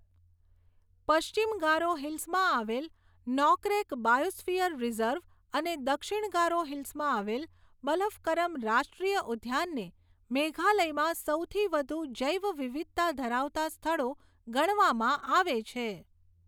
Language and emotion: Gujarati, neutral